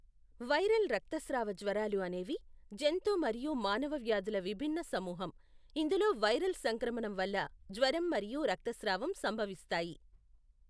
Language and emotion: Telugu, neutral